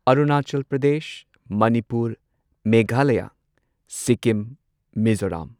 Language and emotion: Manipuri, neutral